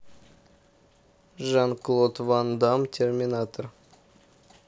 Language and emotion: Russian, neutral